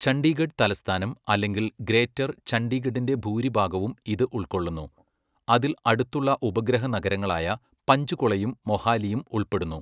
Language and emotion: Malayalam, neutral